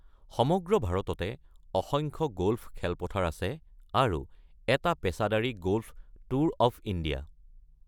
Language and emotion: Assamese, neutral